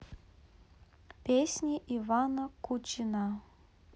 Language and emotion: Russian, neutral